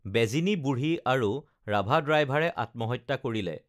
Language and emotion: Assamese, neutral